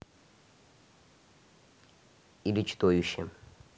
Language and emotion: Russian, neutral